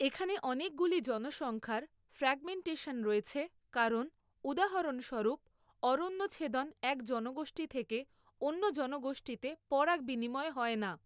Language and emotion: Bengali, neutral